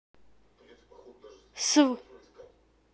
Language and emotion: Russian, neutral